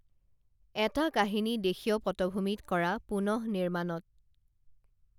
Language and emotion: Assamese, neutral